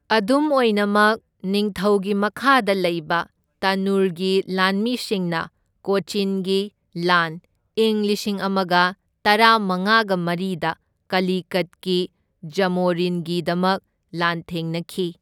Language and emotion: Manipuri, neutral